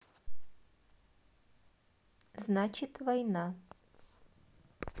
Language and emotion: Russian, neutral